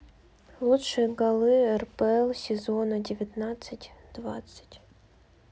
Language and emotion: Russian, neutral